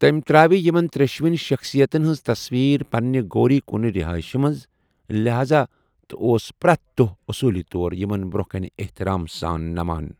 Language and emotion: Kashmiri, neutral